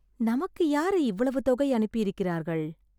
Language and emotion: Tamil, surprised